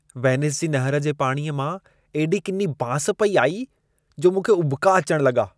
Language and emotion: Sindhi, disgusted